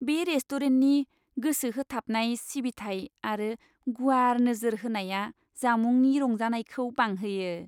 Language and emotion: Bodo, happy